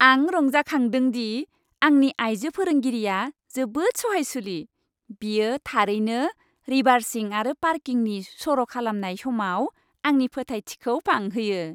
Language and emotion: Bodo, happy